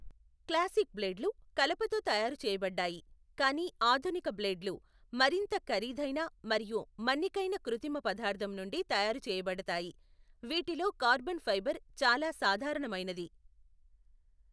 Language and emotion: Telugu, neutral